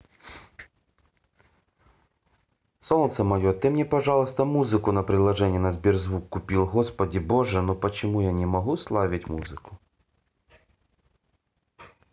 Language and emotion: Russian, neutral